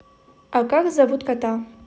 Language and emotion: Russian, neutral